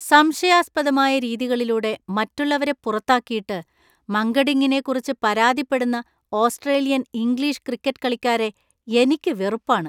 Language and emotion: Malayalam, disgusted